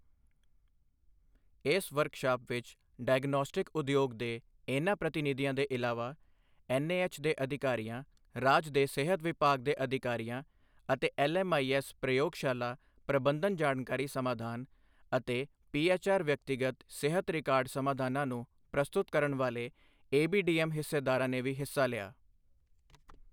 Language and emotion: Punjabi, neutral